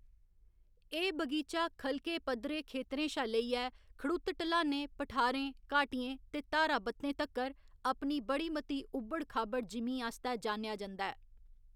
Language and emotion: Dogri, neutral